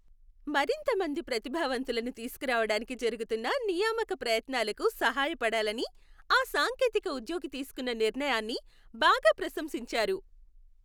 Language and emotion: Telugu, happy